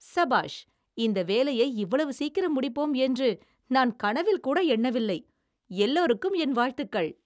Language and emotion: Tamil, surprised